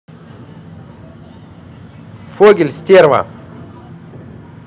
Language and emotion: Russian, angry